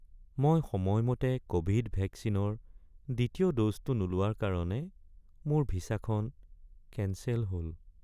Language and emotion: Assamese, sad